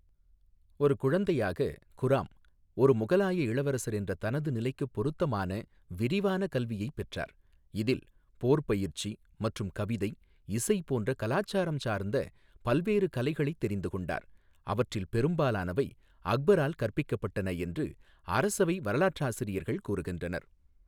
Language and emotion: Tamil, neutral